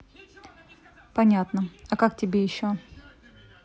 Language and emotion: Russian, neutral